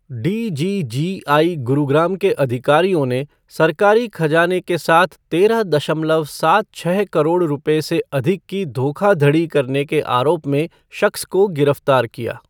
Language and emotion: Hindi, neutral